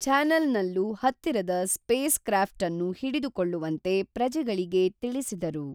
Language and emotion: Kannada, neutral